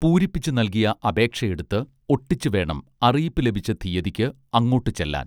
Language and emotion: Malayalam, neutral